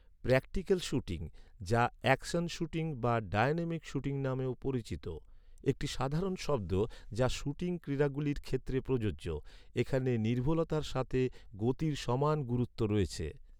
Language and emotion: Bengali, neutral